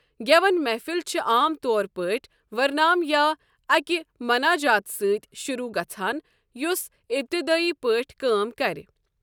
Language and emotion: Kashmiri, neutral